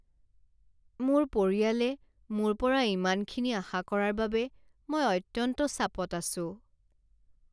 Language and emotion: Assamese, sad